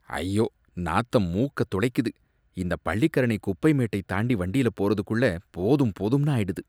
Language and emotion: Tamil, disgusted